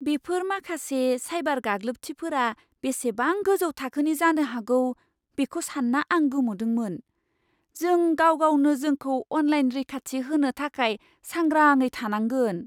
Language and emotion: Bodo, surprised